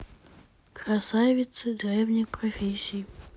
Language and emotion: Russian, sad